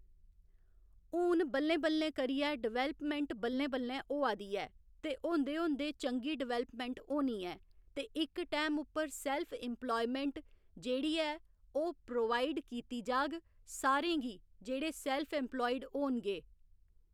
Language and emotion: Dogri, neutral